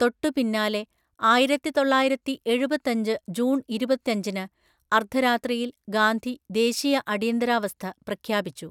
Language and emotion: Malayalam, neutral